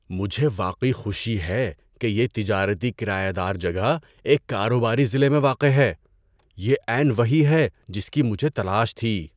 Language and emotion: Urdu, surprised